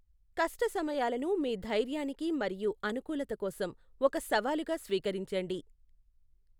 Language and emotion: Telugu, neutral